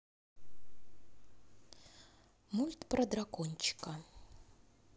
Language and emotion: Russian, neutral